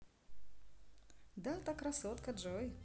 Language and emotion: Russian, positive